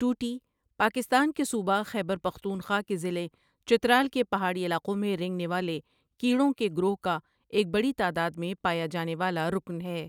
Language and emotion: Urdu, neutral